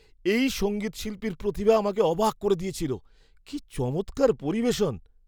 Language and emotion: Bengali, surprised